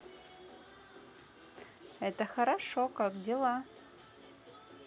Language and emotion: Russian, positive